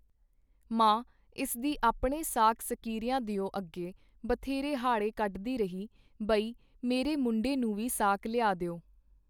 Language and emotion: Punjabi, neutral